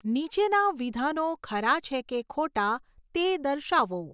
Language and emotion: Gujarati, neutral